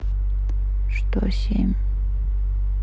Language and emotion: Russian, neutral